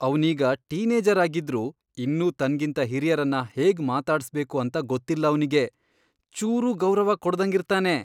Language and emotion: Kannada, disgusted